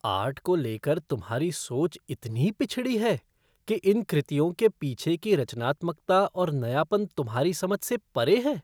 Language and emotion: Hindi, disgusted